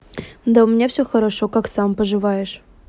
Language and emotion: Russian, neutral